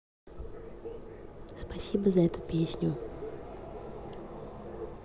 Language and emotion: Russian, neutral